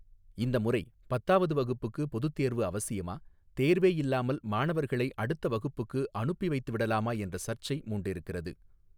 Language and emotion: Tamil, neutral